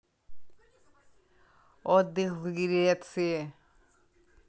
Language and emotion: Russian, neutral